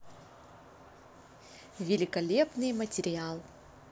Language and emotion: Russian, positive